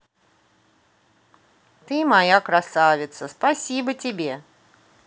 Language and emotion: Russian, positive